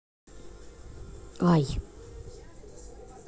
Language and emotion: Russian, neutral